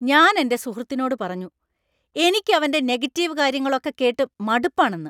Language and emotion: Malayalam, angry